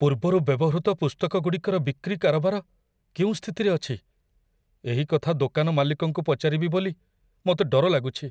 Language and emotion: Odia, fearful